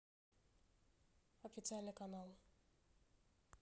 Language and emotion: Russian, neutral